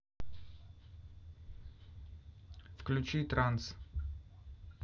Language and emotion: Russian, neutral